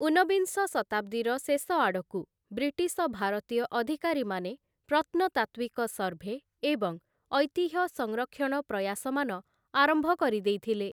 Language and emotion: Odia, neutral